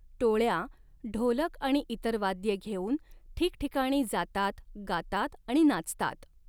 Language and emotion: Marathi, neutral